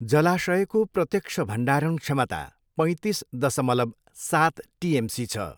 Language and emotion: Nepali, neutral